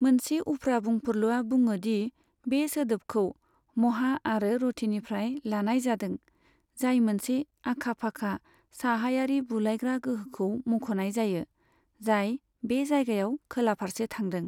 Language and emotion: Bodo, neutral